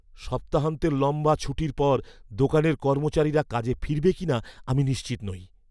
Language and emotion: Bengali, fearful